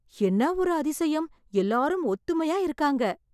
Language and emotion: Tamil, surprised